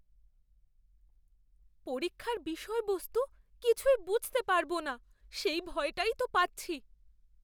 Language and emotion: Bengali, fearful